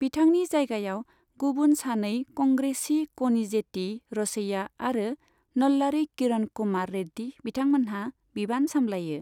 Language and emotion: Bodo, neutral